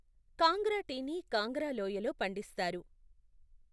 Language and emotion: Telugu, neutral